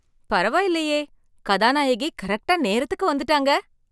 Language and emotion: Tamil, surprised